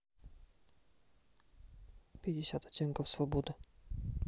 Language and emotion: Russian, neutral